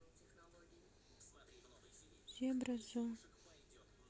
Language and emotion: Russian, sad